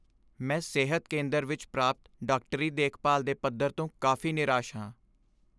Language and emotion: Punjabi, sad